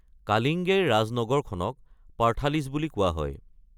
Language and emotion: Assamese, neutral